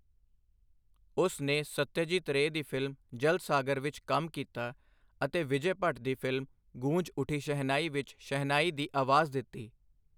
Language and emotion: Punjabi, neutral